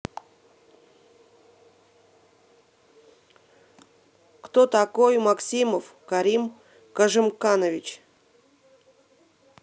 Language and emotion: Russian, neutral